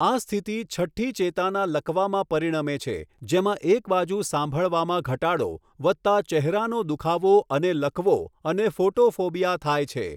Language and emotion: Gujarati, neutral